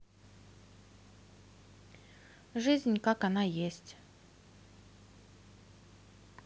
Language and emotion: Russian, neutral